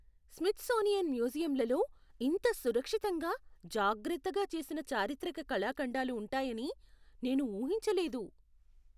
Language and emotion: Telugu, surprised